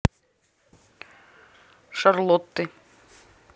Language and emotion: Russian, neutral